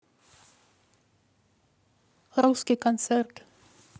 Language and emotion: Russian, neutral